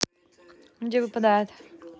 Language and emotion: Russian, neutral